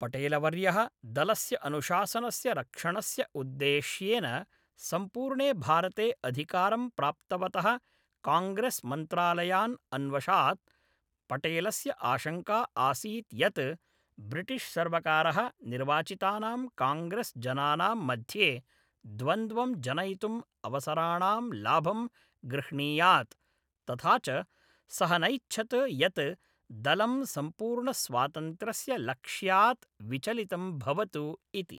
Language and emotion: Sanskrit, neutral